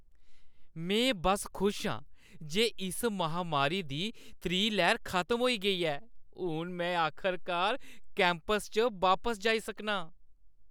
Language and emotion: Dogri, happy